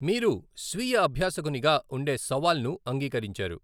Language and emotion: Telugu, neutral